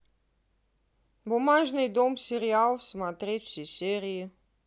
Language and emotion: Russian, neutral